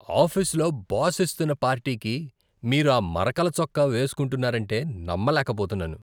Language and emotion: Telugu, disgusted